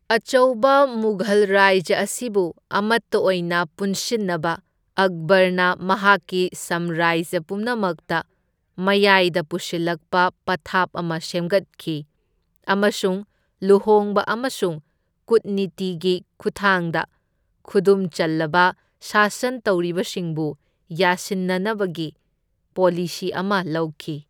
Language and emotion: Manipuri, neutral